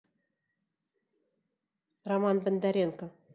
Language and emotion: Russian, neutral